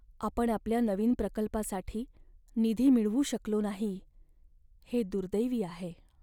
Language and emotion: Marathi, sad